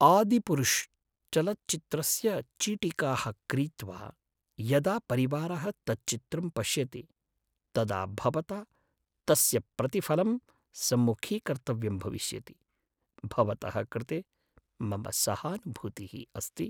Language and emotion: Sanskrit, sad